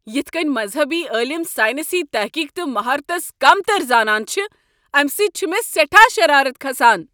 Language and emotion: Kashmiri, angry